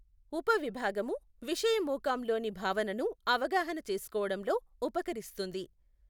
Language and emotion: Telugu, neutral